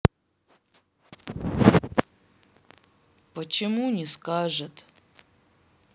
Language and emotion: Russian, sad